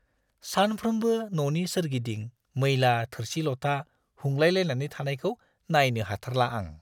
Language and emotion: Bodo, disgusted